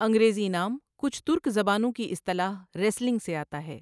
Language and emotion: Urdu, neutral